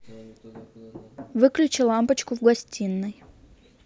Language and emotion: Russian, neutral